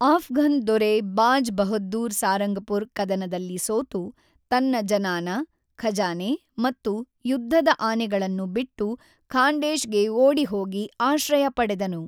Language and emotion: Kannada, neutral